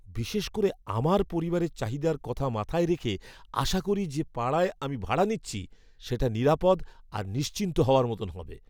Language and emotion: Bengali, fearful